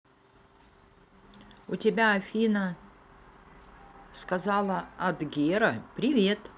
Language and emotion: Russian, neutral